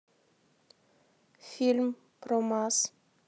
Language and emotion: Russian, neutral